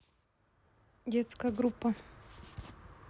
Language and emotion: Russian, neutral